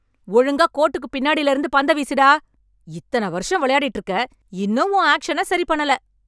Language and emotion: Tamil, angry